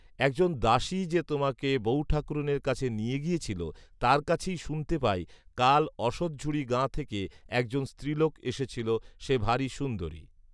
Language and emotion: Bengali, neutral